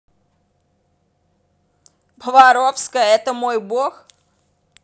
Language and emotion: Russian, angry